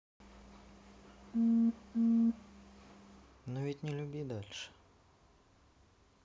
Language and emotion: Russian, sad